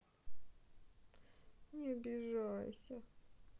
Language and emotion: Russian, sad